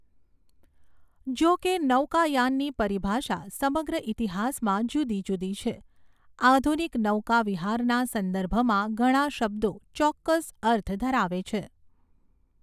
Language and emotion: Gujarati, neutral